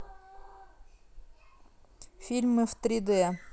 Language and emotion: Russian, neutral